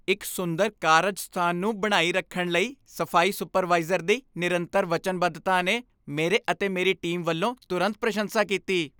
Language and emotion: Punjabi, happy